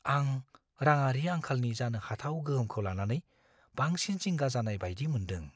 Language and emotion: Bodo, fearful